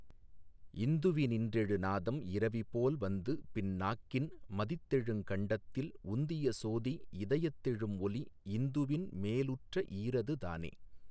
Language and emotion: Tamil, neutral